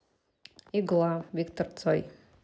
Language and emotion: Russian, neutral